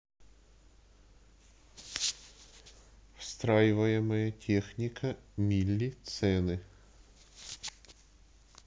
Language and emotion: Russian, neutral